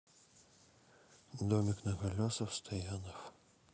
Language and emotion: Russian, sad